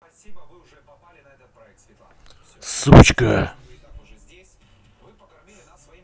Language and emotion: Russian, angry